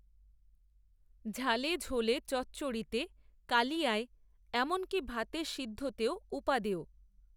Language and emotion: Bengali, neutral